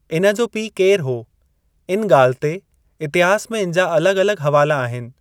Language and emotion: Sindhi, neutral